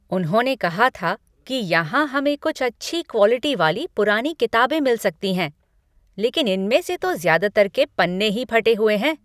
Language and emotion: Hindi, angry